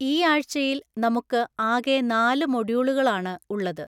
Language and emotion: Malayalam, neutral